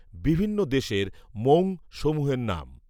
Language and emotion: Bengali, neutral